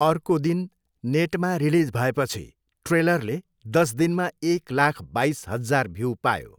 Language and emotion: Nepali, neutral